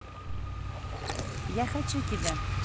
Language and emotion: Russian, positive